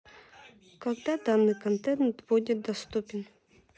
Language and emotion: Russian, neutral